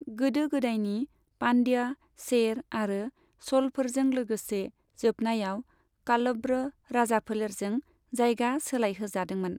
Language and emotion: Bodo, neutral